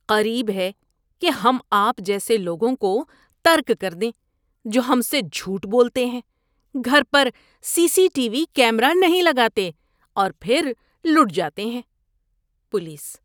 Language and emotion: Urdu, disgusted